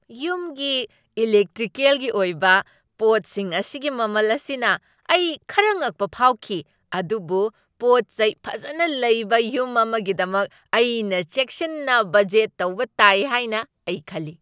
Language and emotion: Manipuri, surprised